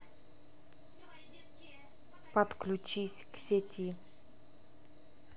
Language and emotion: Russian, neutral